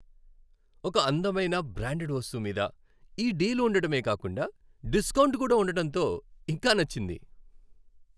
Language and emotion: Telugu, happy